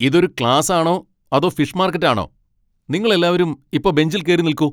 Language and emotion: Malayalam, angry